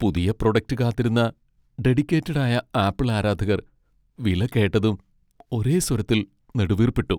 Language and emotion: Malayalam, sad